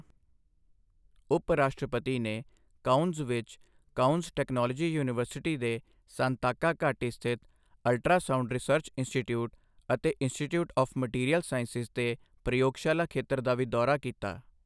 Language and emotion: Punjabi, neutral